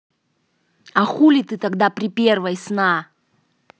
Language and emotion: Russian, angry